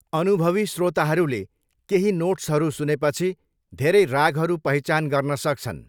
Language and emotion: Nepali, neutral